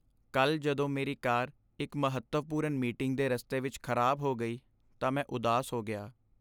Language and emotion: Punjabi, sad